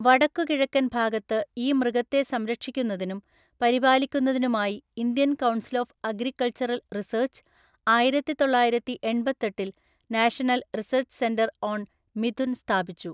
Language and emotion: Malayalam, neutral